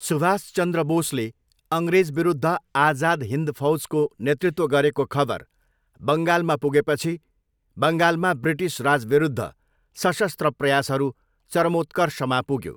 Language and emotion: Nepali, neutral